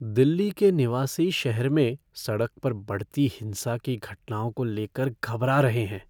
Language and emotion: Hindi, fearful